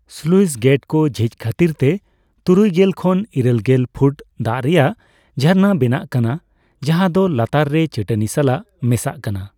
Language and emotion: Santali, neutral